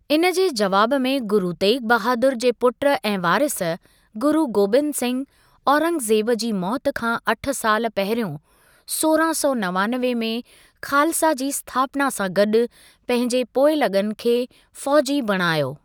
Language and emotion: Sindhi, neutral